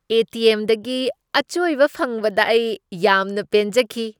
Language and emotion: Manipuri, happy